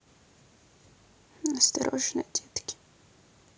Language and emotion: Russian, sad